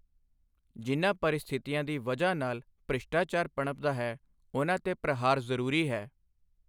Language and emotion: Punjabi, neutral